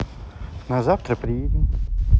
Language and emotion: Russian, neutral